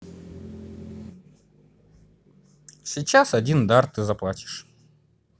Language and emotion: Russian, neutral